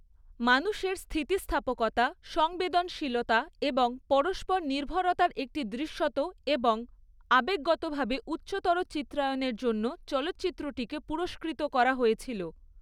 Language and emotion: Bengali, neutral